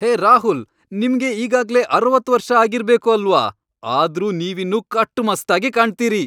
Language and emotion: Kannada, happy